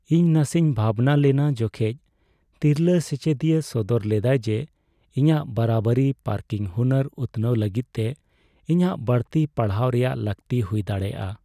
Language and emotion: Santali, sad